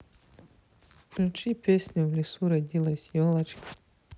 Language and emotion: Russian, neutral